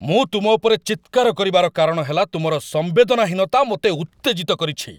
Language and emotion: Odia, angry